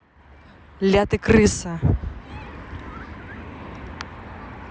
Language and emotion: Russian, angry